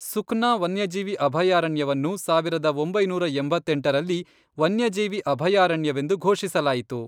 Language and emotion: Kannada, neutral